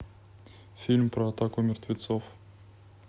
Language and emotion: Russian, neutral